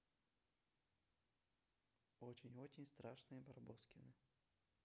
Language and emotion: Russian, neutral